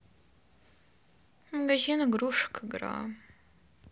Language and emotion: Russian, sad